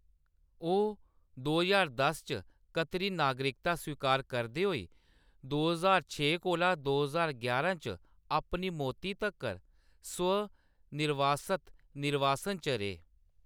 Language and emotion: Dogri, neutral